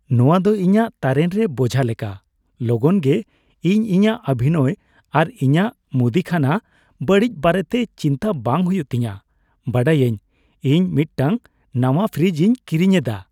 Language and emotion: Santali, happy